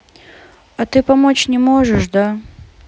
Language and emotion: Russian, sad